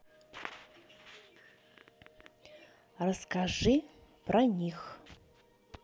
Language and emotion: Russian, neutral